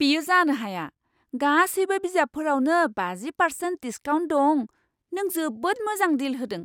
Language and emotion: Bodo, surprised